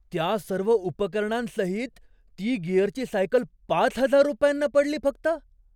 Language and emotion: Marathi, surprised